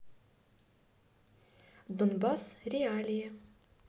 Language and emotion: Russian, neutral